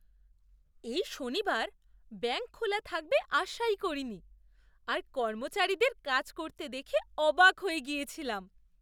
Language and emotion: Bengali, surprised